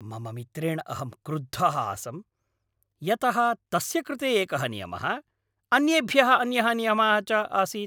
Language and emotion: Sanskrit, angry